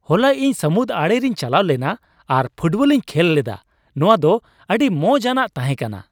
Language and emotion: Santali, happy